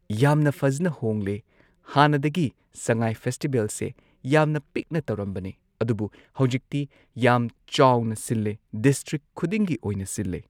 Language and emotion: Manipuri, neutral